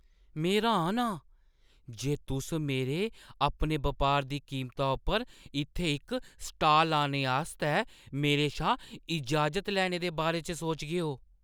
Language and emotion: Dogri, surprised